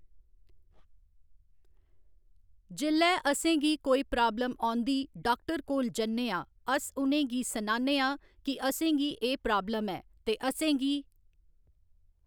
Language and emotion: Dogri, neutral